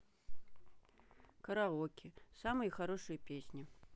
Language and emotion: Russian, neutral